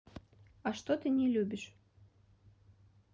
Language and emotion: Russian, neutral